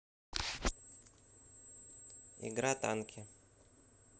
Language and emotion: Russian, neutral